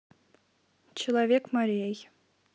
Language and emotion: Russian, neutral